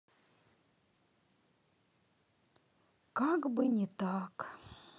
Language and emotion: Russian, sad